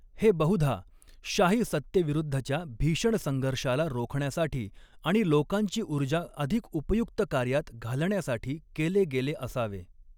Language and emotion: Marathi, neutral